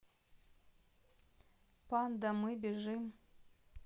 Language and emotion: Russian, neutral